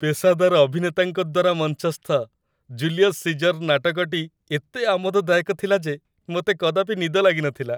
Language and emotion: Odia, happy